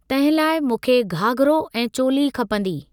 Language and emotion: Sindhi, neutral